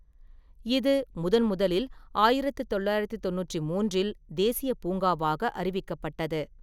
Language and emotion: Tamil, neutral